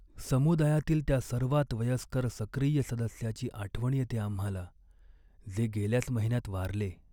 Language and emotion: Marathi, sad